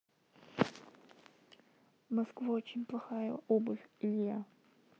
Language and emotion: Russian, neutral